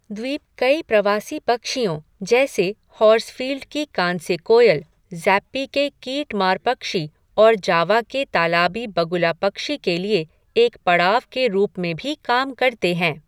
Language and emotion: Hindi, neutral